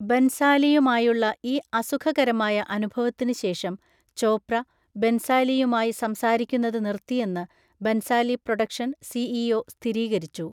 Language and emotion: Malayalam, neutral